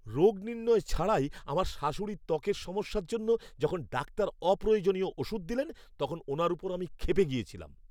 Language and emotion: Bengali, angry